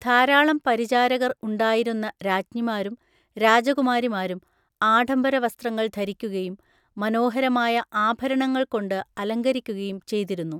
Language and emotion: Malayalam, neutral